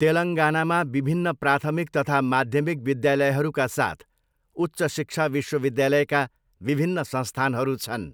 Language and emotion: Nepali, neutral